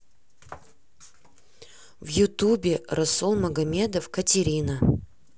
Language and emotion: Russian, neutral